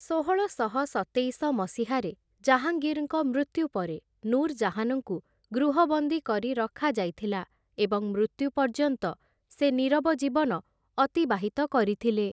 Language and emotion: Odia, neutral